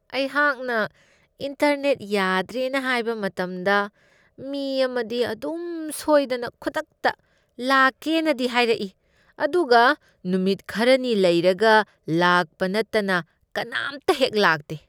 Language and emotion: Manipuri, disgusted